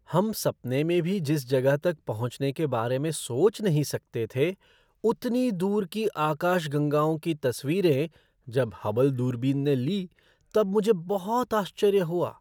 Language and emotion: Hindi, surprised